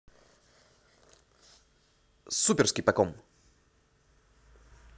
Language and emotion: Russian, positive